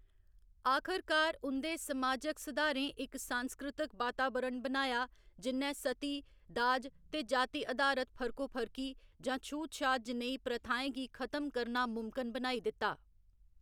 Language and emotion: Dogri, neutral